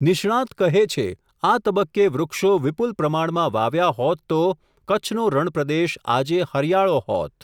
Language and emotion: Gujarati, neutral